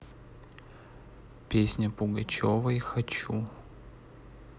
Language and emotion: Russian, neutral